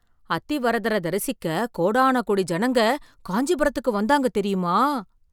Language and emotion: Tamil, surprised